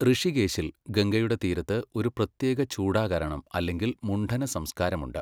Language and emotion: Malayalam, neutral